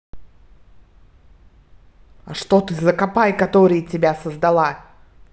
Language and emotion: Russian, angry